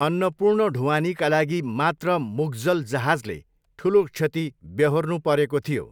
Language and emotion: Nepali, neutral